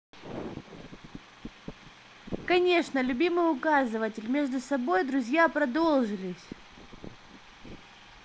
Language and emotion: Russian, positive